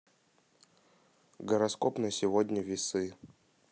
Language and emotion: Russian, neutral